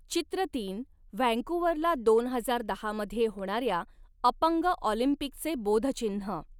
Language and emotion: Marathi, neutral